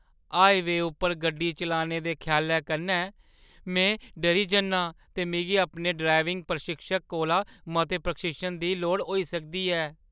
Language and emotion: Dogri, fearful